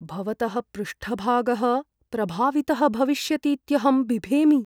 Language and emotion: Sanskrit, fearful